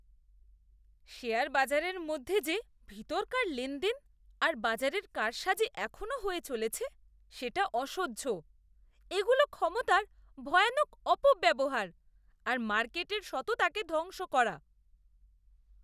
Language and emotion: Bengali, disgusted